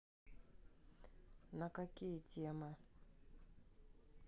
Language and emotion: Russian, neutral